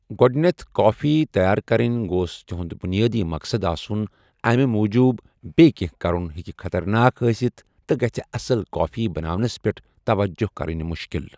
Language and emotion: Kashmiri, neutral